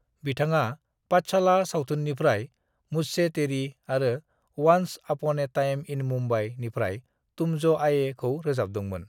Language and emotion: Bodo, neutral